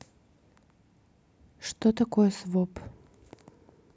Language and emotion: Russian, neutral